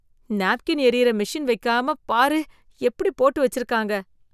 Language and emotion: Tamil, disgusted